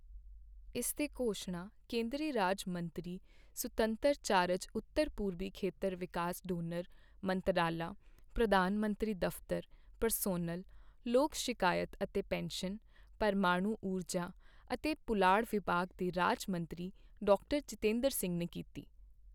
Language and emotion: Punjabi, neutral